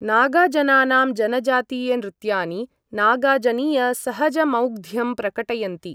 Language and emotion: Sanskrit, neutral